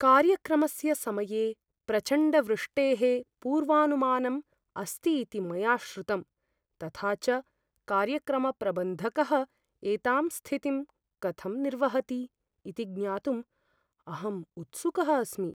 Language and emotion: Sanskrit, fearful